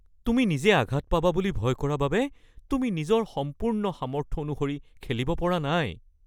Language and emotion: Assamese, fearful